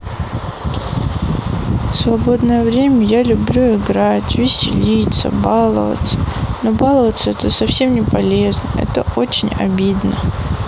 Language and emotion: Russian, sad